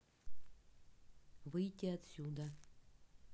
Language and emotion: Russian, neutral